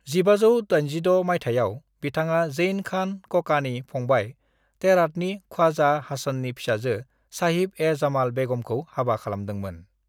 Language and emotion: Bodo, neutral